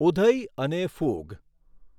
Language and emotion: Gujarati, neutral